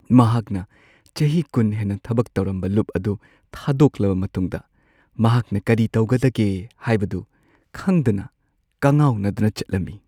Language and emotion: Manipuri, sad